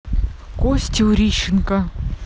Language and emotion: Russian, neutral